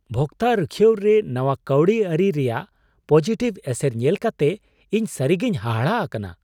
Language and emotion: Santali, surprised